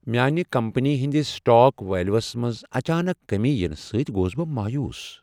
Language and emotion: Kashmiri, sad